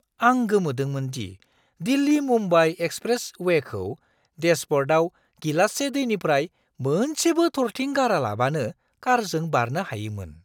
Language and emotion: Bodo, surprised